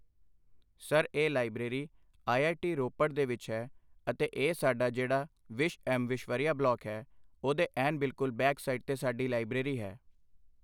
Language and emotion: Punjabi, neutral